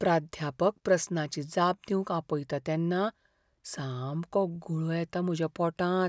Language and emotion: Goan Konkani, fearful